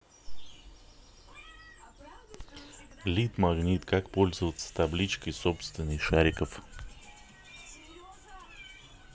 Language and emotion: Russian, neutral